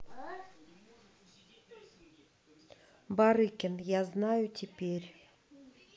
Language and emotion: Russian, neutral